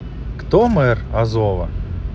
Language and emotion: Russian, positive